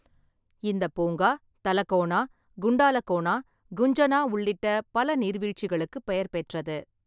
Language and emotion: Tamil, neutral